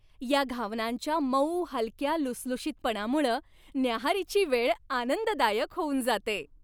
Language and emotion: Marathi, happy